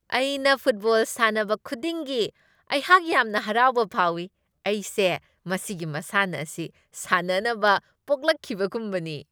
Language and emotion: Manipuri, happy